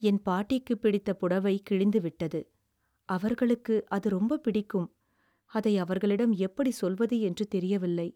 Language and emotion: Tamil, sad